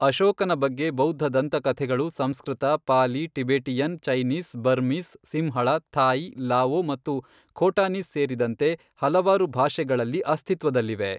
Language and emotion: Kannada, neutral